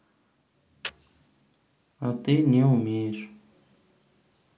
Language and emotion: Russian, neutral